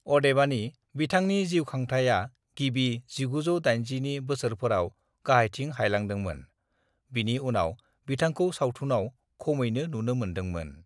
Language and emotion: Bodo, neutral